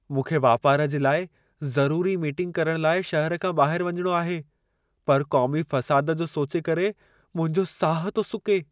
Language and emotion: Sindhi, fearful